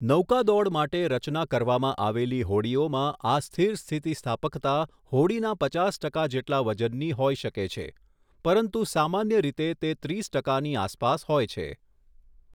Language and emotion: Gujarati, neutral